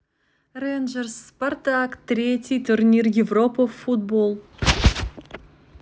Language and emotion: Russian, neutral